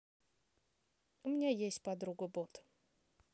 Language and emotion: Russian, neutral